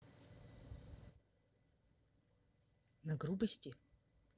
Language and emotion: Russian, neutral